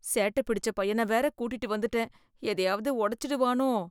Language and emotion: Tamil, fearful